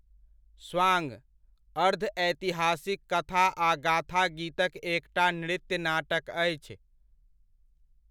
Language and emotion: Maithili, neutral